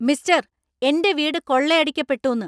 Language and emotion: Malayalam, angry